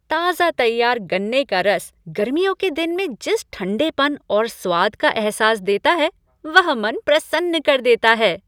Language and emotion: Hindi, happy